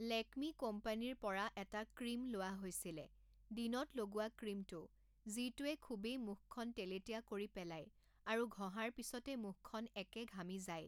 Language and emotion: Assamese, neutral